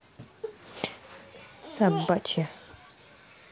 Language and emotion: Russian, angry